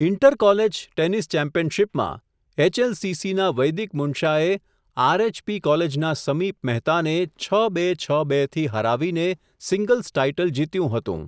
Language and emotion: Gujarati, neutral